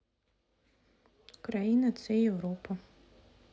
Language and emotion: Russian, neutral